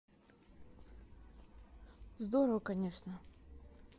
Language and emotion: Russian, neutral